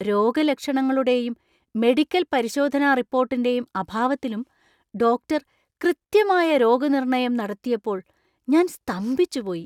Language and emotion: Malayalam, surprised